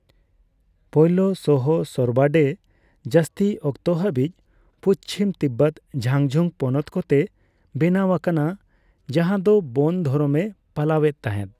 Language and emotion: Santali, neutral